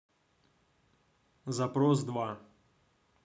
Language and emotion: Russian, neutral